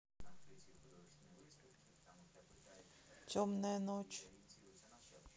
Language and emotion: Russian, neutral